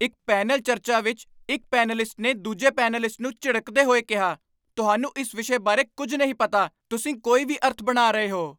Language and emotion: Punjabi, angry